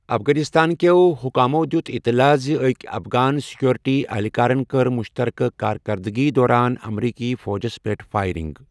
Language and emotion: Kashmiri, neutral